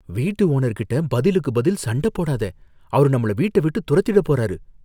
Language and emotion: Tamil, fearful